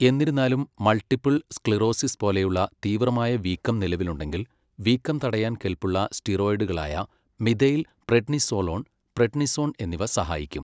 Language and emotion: Malayalam, neutral